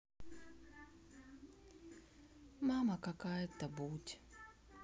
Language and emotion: Russian, sad